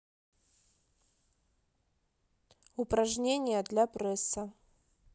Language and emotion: Russian, neutral